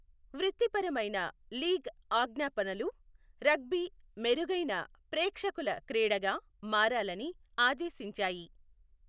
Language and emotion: Telugu, neutral